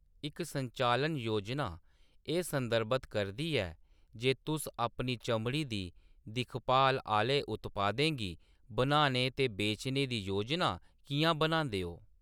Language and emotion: Dogri, neutral